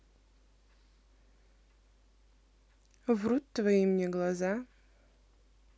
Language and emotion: Russian, neutral